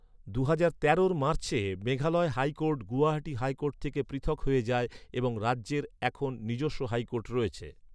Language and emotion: Bengali, neutral